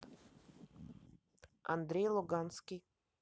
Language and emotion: Russian, neutral